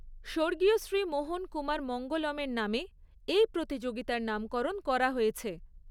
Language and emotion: Bengali, neutral